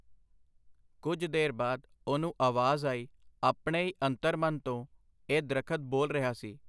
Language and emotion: Punjabi, neutral